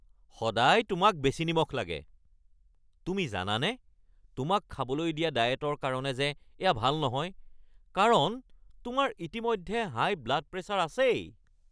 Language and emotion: Assamese, angry